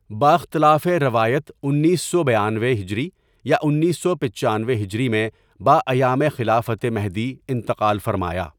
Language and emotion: Urdu, neutral